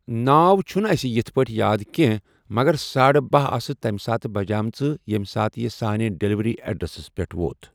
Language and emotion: Kashmiri, neutral